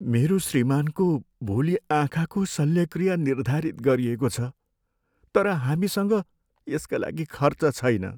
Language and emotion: Nepali, sad